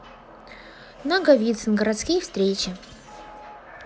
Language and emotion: Russian, neutral